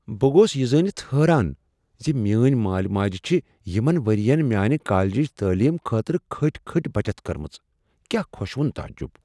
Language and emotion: Kashmiri, surprised